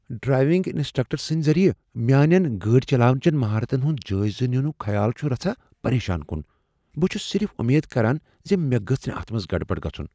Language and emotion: Kashmiri, fearful